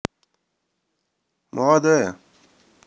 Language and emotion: Russian, neutral